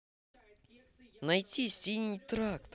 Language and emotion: Russian, positive